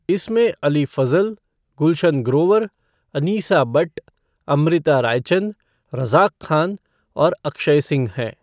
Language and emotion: Hindi, neutral